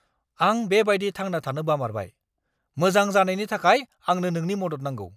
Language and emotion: Bodo, angry